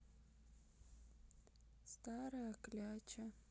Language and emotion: Russian, sad